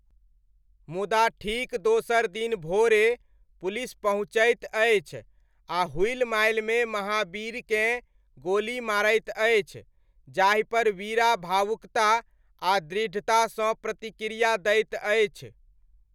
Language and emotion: Maithili, neutral